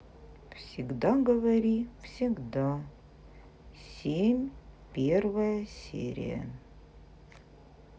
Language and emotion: Russian, sad